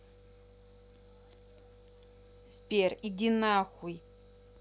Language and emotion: Russian, angry